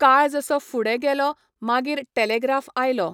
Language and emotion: Goan Konkani, neutral